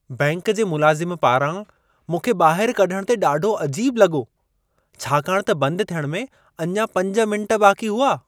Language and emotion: Sindhi, surprised